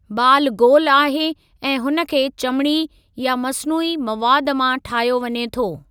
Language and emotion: Sindhi, neutral